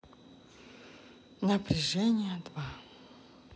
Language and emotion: Russian, sad